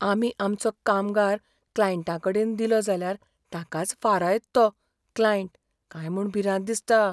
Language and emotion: Goan Konkani, fearful